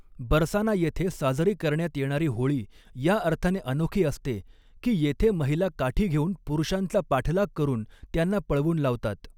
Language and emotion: Marathi, neutral